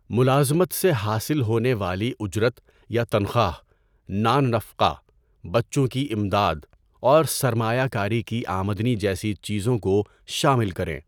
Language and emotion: Urdu, neutral